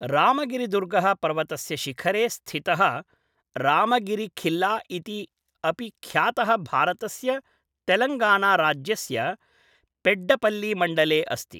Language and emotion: Sanskrit, neutral